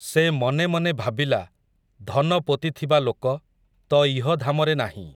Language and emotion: Odia, neutral